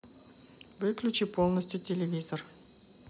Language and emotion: Russian, neutral